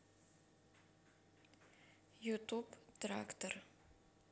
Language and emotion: Russian, neutral